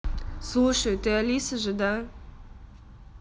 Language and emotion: Russian, neutral